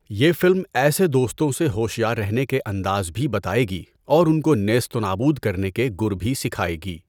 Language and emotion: Urdu, neutral